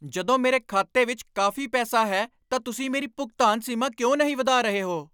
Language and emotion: Punjabi, angry